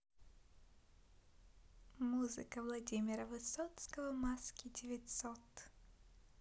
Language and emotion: Russian, neutral